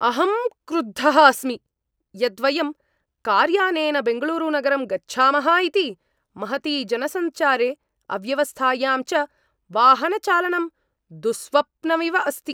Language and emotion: Sanskrit, angry